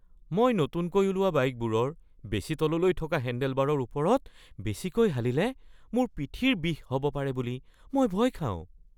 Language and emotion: Assamese, fearful